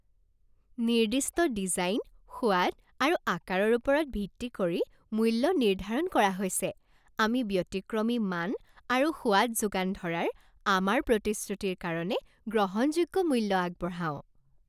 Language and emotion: Assamese, happy